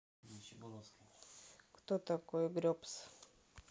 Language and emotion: Russian, neutral